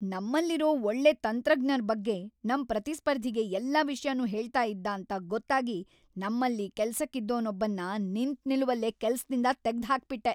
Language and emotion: Kannada, angry